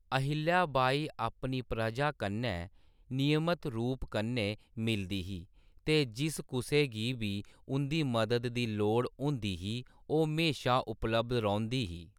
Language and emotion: Dogri, neutral